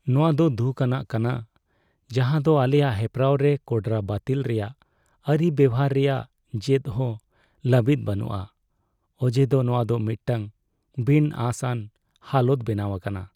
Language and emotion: Santali, sad